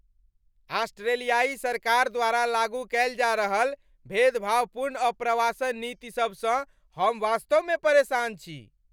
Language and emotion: Maithili, angry